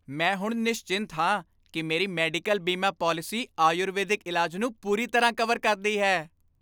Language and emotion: Punjabi, happy